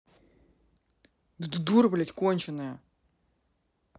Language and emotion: Russian, angry